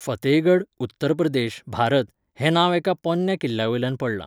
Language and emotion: Goan Konkani, neutral